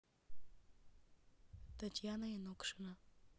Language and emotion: Russian, neutral